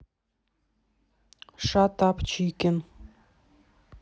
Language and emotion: Russian, neutral